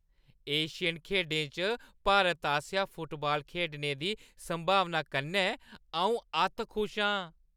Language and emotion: Dogri, happy